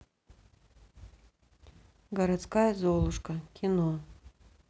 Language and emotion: Russian, neutral